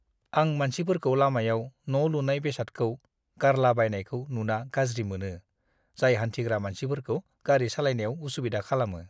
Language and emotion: Bodo, disgusted